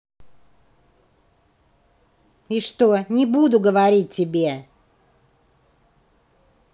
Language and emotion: Russian, angry